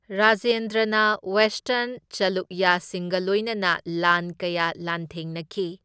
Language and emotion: Manipuri, neutral